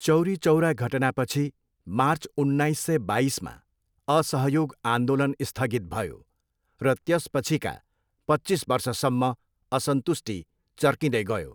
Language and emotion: Nepali, neutral